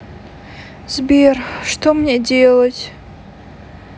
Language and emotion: Russian, sad